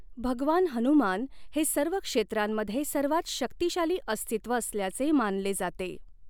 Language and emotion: Marathi, neutral